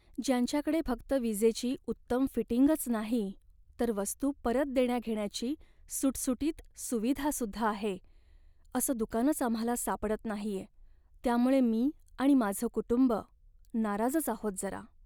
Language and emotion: Marathi, sad